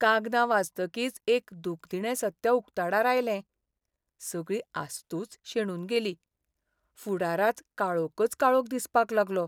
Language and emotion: Goan Konkani, sad